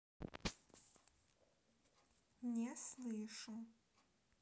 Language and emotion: Russian, neutral